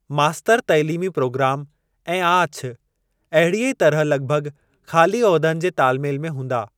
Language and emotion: Sindhi, neutral